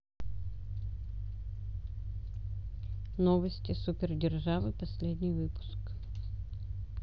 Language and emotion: Russian, neutral